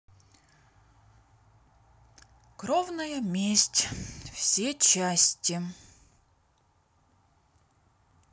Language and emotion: Russian, neutral